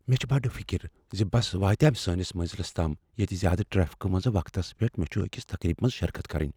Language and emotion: Kashmiri, fearful